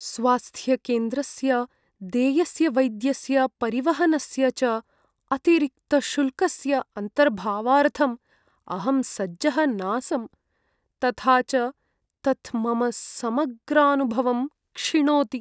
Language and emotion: Sanskrit, sad